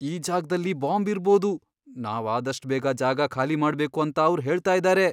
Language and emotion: Kannada, fearful